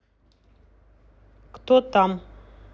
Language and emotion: Russian, neutral